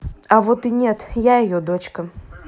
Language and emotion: Russian, neutral